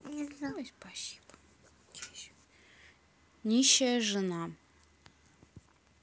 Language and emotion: Russian, neutral